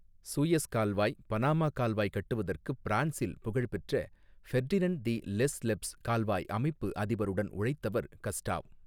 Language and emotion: Tamil, neutral